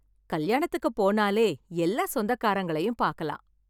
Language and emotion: Tamil, happy